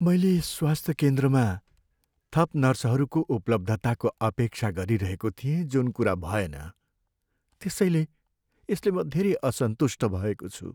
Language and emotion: Nepali, sad